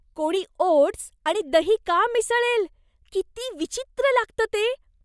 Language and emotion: Marathi, disgusted